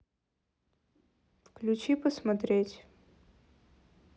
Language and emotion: Russian, neutral